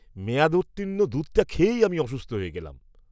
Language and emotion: Bengali, disgusted